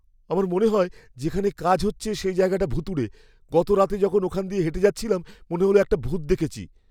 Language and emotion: Bengali, fearful